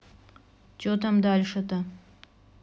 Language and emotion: Russian, neutral